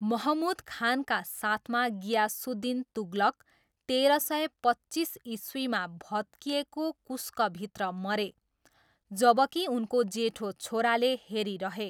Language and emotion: Nepali, neutral